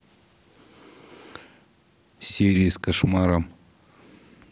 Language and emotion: Russian, neutral